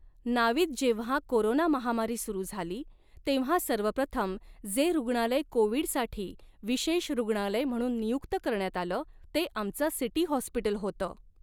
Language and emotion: Marathi, neutral